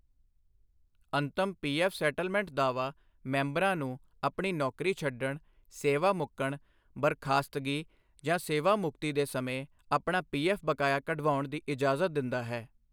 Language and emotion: Punjabi, neutral